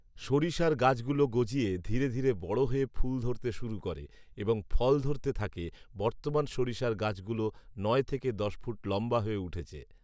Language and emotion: Bengali, neutral